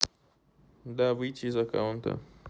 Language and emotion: Russian, neutral